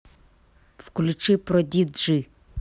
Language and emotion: Russian, angry